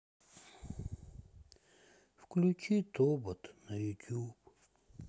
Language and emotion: Russian, sad